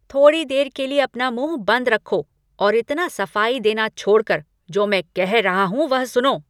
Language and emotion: Hindi, angry